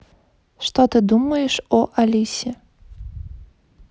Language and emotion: Russian, neutral